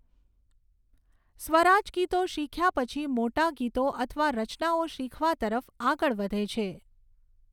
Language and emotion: Gujarati, neutral